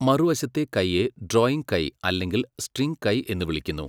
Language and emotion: Malayalam, neutral